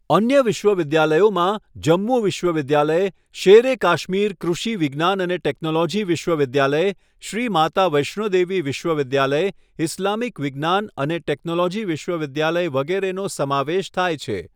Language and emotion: Gujarati, neutral